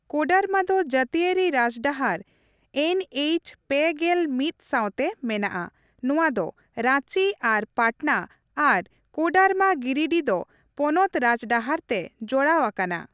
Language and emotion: Santali, neutral